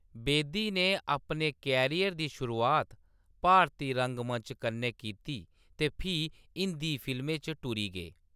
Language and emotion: Dogri, neutral